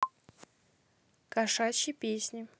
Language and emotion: Russian, neutral